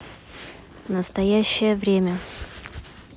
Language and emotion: Russian, neutral